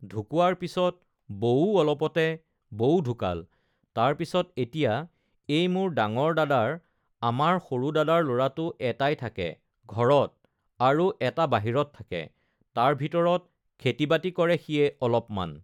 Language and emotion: Assamese, neutral